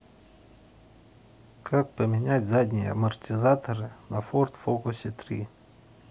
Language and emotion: Russian, neutral